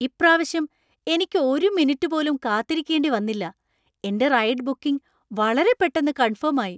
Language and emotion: Malayalam, surprised